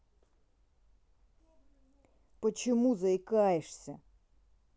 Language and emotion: Russian, angry